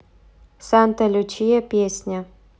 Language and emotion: Russian, neutral